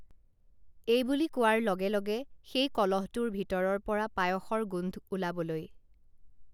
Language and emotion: Assamese, neutral